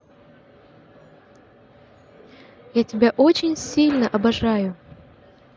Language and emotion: Russian, positive